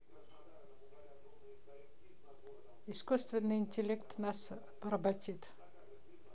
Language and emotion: Russian, neutral